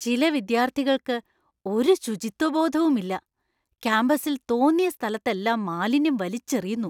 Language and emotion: Malayalam, disgusted